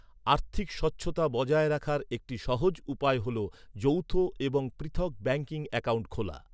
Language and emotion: Bengali, neutral